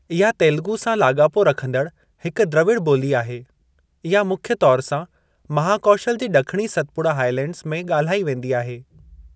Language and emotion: Sindhi, neutral